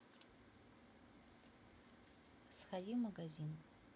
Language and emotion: Russian, neutral